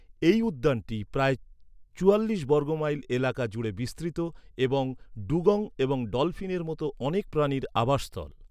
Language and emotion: Bengali, neutral